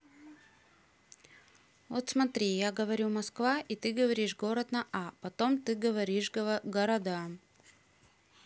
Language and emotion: Russian, neutral